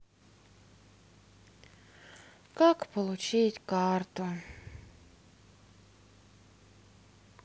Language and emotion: Russian, sad